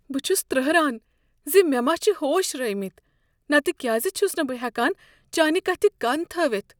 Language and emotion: Kashmiri, fearful